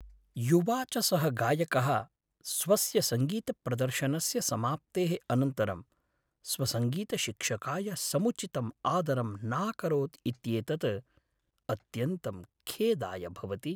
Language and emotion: Sanskrit, sad